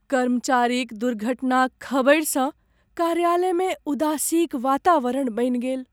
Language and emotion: Maithili, sad